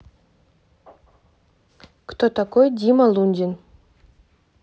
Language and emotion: Russian, neutral